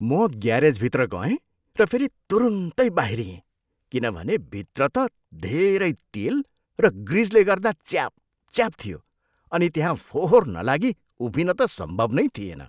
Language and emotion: Nepali, disgusted